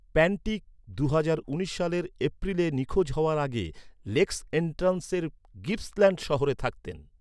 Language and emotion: Bengali, neutral